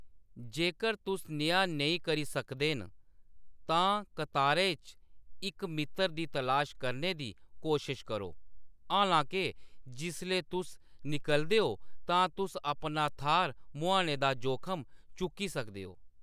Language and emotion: Dogri, neutral